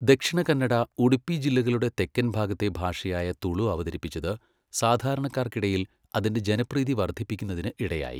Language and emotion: Malayalam, neutral